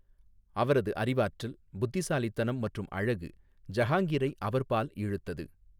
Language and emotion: Tamil, neutral